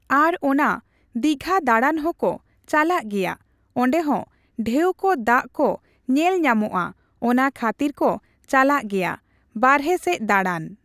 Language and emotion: Santali, neutral